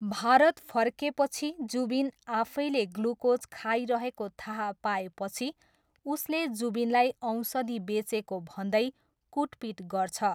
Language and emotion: Nepali, neutral